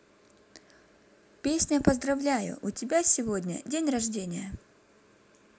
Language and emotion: Russian, positive